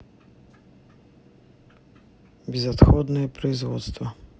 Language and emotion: Russian, neutral